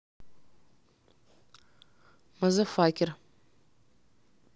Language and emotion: Russian, neutral